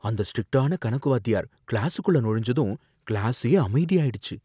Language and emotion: Tamil, fearful